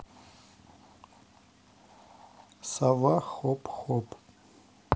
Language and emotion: Russian, neutral